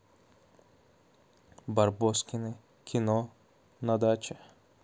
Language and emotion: Russian, neutral